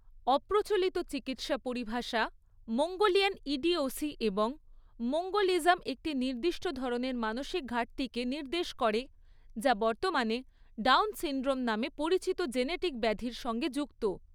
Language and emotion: Bengali, neutral